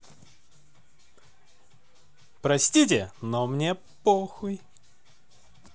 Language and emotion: Russian, positive